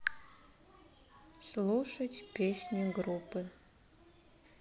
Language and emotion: Russian, sad